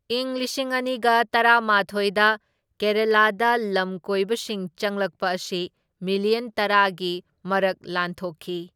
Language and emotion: Manipuri, neutral